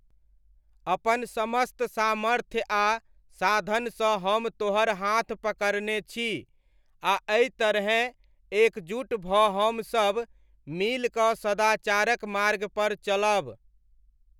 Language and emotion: Maithili, neutral